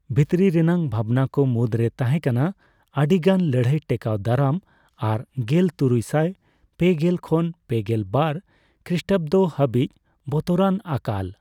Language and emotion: Santali, neutral